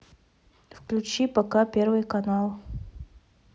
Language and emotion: Russian, neutral